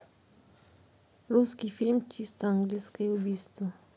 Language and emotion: Russian, neutral